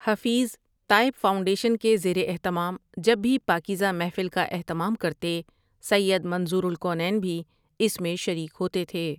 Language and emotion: Urdu, neutral